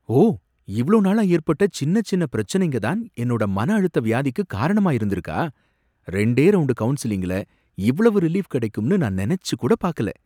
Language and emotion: Tamil, surprised